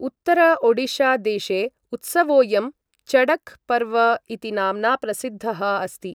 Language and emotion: Sanskrit, neutral